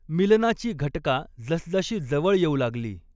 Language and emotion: Marathi, neutral